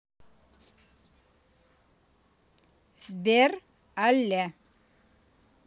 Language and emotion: Russian, neutral